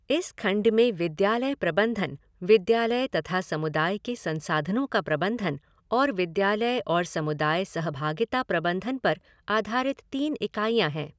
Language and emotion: Hindi, neutral